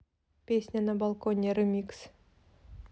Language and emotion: Russian, neutral